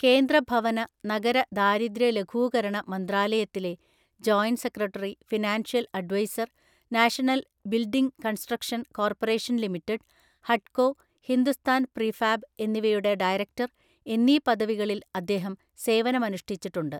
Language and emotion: Malayalam, neutral